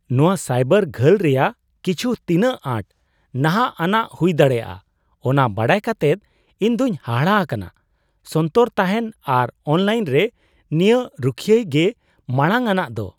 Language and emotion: Santali, surprised